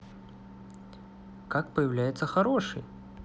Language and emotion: Russian, positive